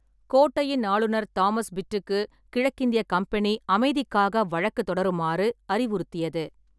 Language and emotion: Tamil, neutral